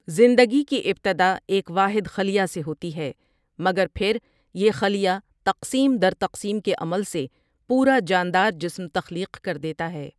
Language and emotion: Urdu, neutral